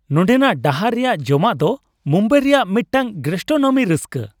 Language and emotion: Santali, happy